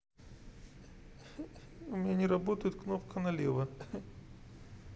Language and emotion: Russian, sad